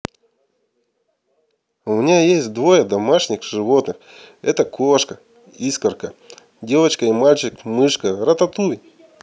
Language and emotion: Russian, positive